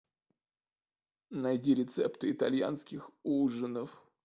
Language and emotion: Russian, sad